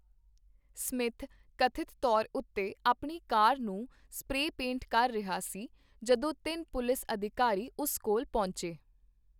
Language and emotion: Punjabi, neutral